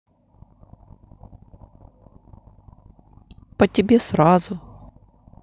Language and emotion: Russian, neutral